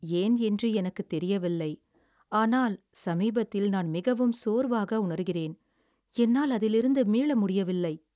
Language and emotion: Tamil, sad